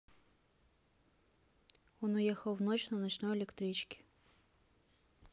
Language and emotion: Russian, neutral